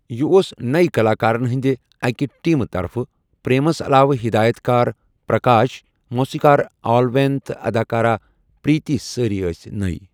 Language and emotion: Kashmiri, neutral